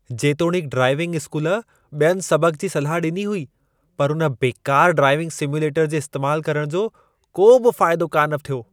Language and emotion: Sindhi, disgusted